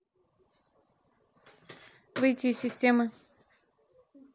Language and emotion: Russian, neutral